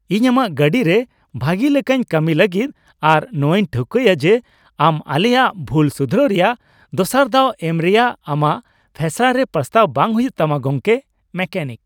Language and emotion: Santali, happy